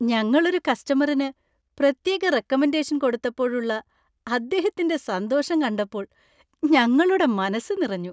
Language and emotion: Malayalam, happy